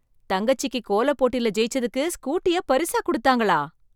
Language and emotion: Tamil, surprised